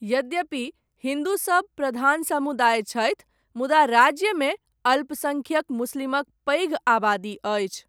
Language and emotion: Maithili, neutral